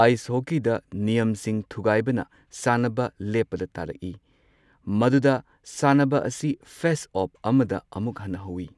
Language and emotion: Manipuri, neutral